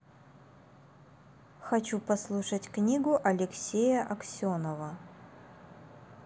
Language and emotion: Russian, neutral